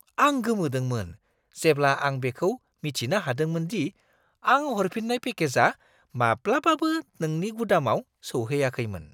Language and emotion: Bodo, surprised